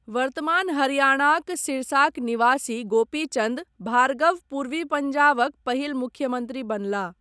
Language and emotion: Maithili, neutral